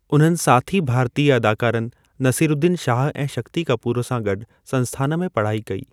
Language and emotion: Sindhi, neutral